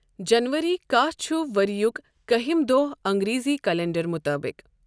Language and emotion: Kashmiri, neutral